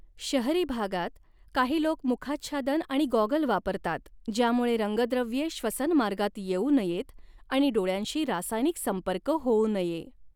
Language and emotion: Marathi, neutral